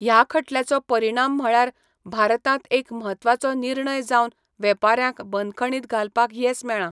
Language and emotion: Goan Konkani, neutral